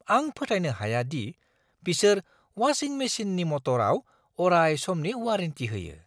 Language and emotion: Bodo, surprised